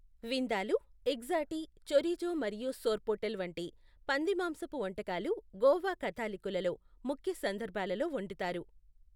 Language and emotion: Telugu, neutral